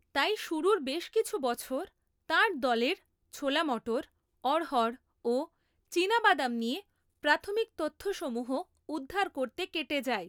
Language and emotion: Bengali, neutral